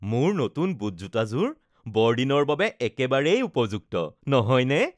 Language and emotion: Assamese, happy